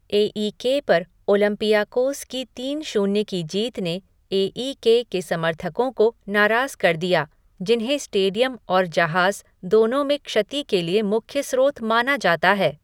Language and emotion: Hindi, neutral